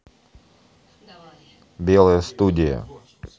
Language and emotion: Russian, neutral